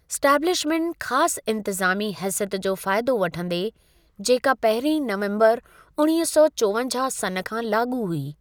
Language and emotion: Sindhi, neutral